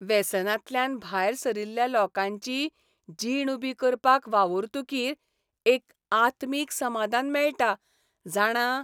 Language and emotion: Goan Konkani, happy